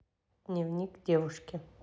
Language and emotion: Russian, neutral